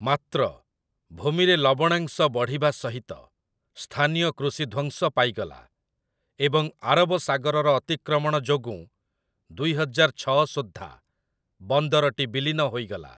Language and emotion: Odia, neutral